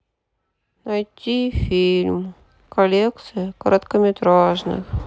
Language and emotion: Russian, sad